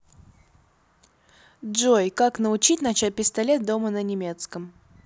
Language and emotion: Russian, positive